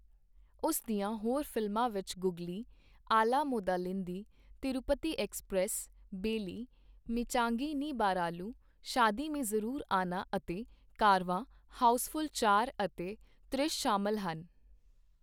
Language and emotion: Punjabi, neutral